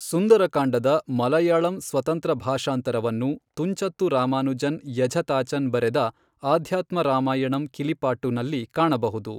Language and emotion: Kannada, neutral